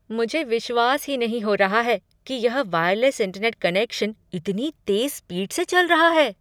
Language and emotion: Hindi, surprised